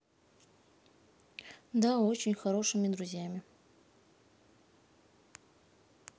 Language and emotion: Russian, neutral